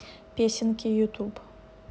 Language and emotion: Russian, neutral